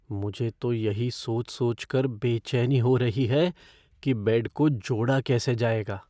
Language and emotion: Hindi, fearful